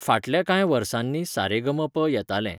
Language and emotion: Goan Konkani, neutral